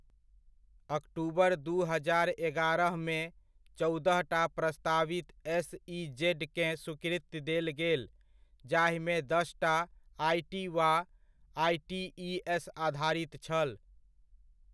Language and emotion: Maithili, neutral